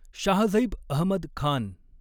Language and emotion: Marathi, neutral